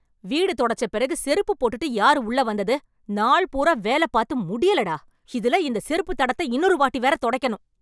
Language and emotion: Tamil, angry